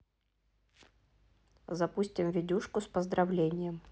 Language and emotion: Russian, neutral